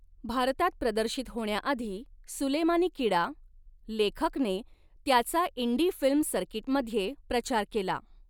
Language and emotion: Marathi, neutral